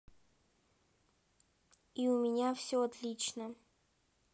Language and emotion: Russian, neutral